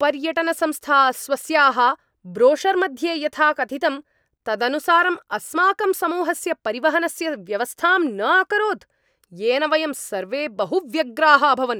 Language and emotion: Sanskrit, angry